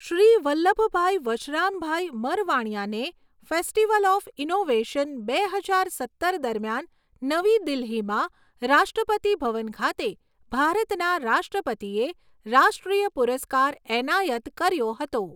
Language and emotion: Gujarati, neutral